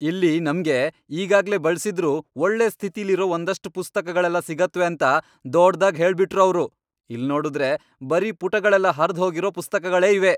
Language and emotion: Kannada, angry